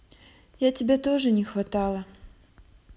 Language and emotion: Russian, sad